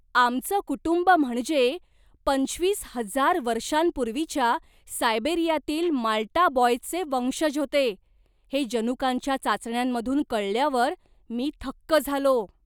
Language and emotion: Marathi, surprised